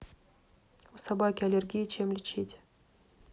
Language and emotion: Russian, neutral